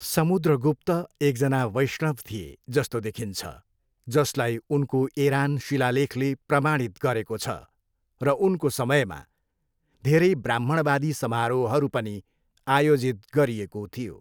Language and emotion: Nepali, neutral